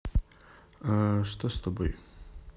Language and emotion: Russian, neutral